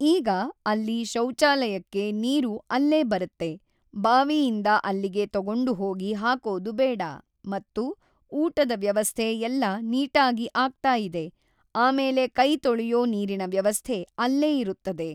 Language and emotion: Kannada, neutral